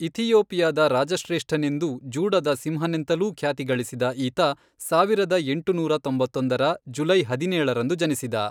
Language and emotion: Kannada, neutral